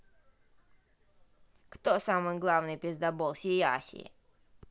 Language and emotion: Russian, angry